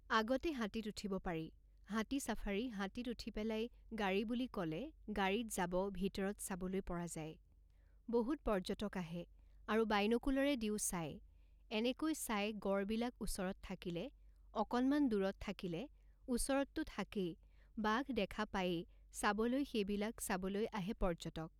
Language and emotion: Assamese, neutral